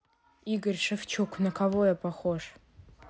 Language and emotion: Russian, neutral